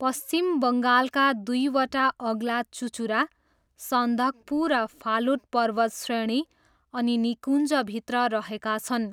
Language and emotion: Nepali, neutral